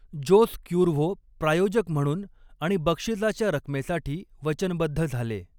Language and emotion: Marathi, neutral